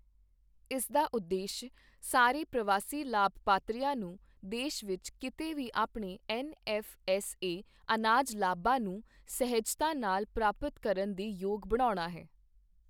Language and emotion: Punjabi, neutral